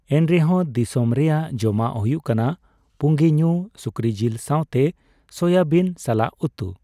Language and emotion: Santali, neutral